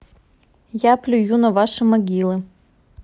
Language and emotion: Russian, neutral